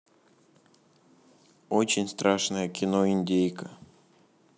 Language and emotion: Russian, neutral